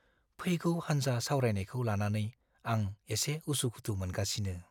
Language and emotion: Bodo, fearful